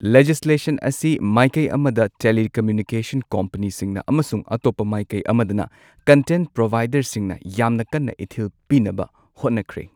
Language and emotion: Manipuri, neutral